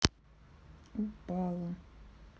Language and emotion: Russian, sad